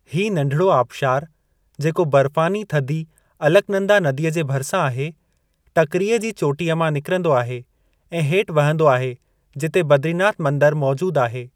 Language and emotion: Sindhi, neutral